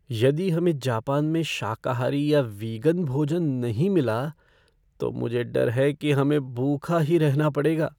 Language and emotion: Hindi, fearful